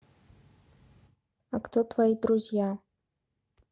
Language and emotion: Russian, neutral